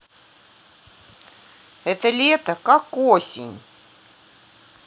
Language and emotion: Russian, neutral